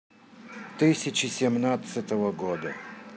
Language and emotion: Russian, neutral